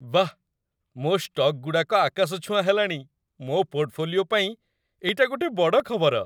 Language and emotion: Odia, happy